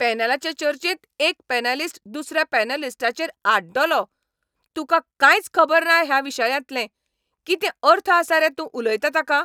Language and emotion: Goan Konkani, angry